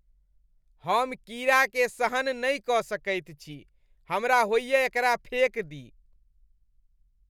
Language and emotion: Maithili, disgusted